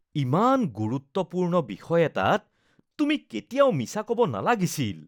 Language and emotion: Assamese, disgusted